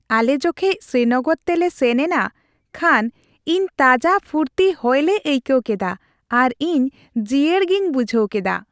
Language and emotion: Santali, happy